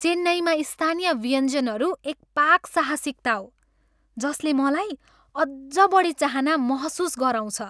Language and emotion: Nepali, happy